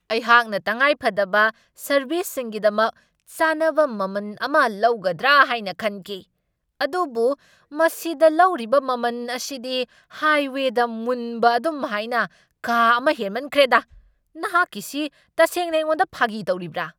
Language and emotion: Manipuri, angry